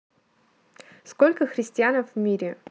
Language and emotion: Russian, neutral